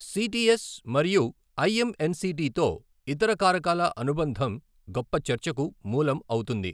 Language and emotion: Telugu, neutral